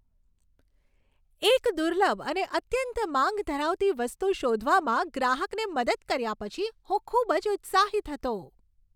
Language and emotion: Gujarati, happy